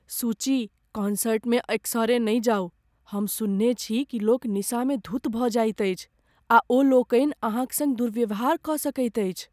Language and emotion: Maithili, fearful